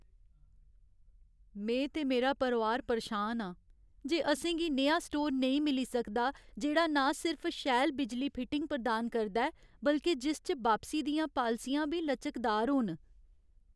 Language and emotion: Dogri, sad